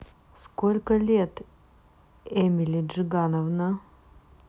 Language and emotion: Russian, neutral